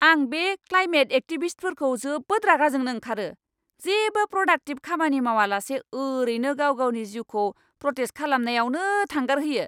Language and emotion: Bodo, angry